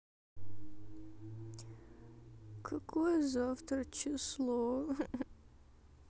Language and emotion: Russian, sad